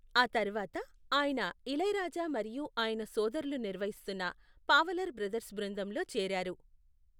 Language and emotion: Telugu, neutral